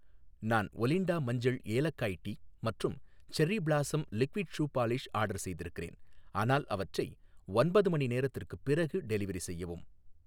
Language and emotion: Tamil, neutral